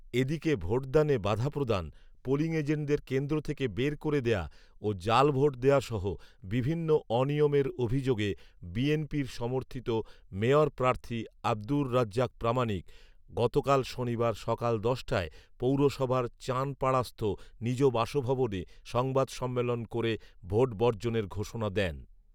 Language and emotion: Bengali, neutral